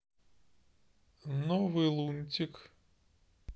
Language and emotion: Russian, neutral